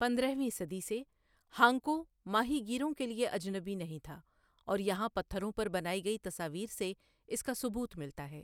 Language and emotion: Urdu, neutral